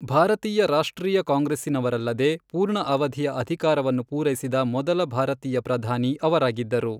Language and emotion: Kannada, neutral